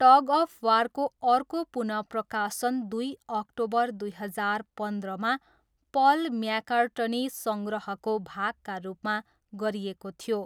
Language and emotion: Nepali, neutral